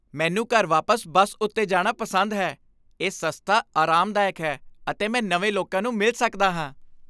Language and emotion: Punjabi, happy